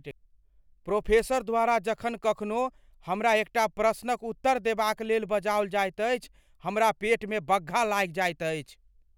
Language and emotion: Maithili, fearful